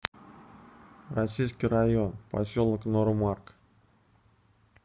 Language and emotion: Russian, neutral